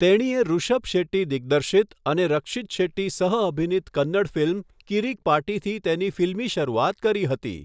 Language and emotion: Gujarati, neutral